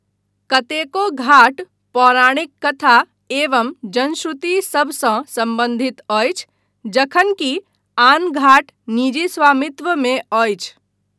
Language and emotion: Maithili, neutral